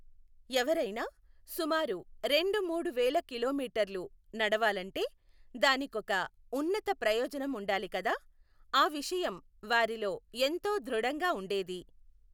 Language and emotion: Telugu, neutral